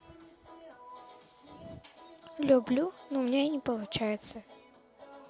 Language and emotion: Russian, neutral